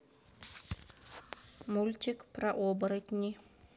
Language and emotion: Russian, neutral